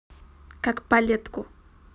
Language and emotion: Russian, neutral